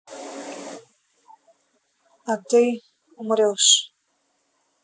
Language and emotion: Russian, neutral